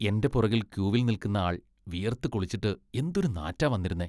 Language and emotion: Malayalam, disgusted